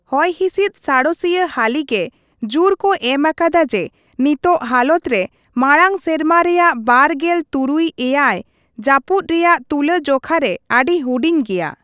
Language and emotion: Santali, neutral